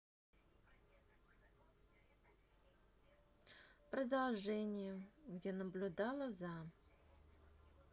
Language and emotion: Russian, neutral